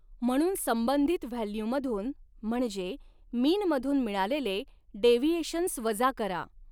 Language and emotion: Marathi, neutral